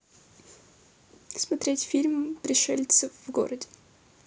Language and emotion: Russian, neutral